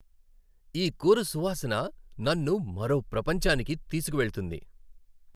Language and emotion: Telugu, happy